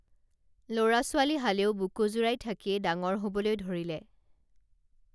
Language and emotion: Assamese, neutral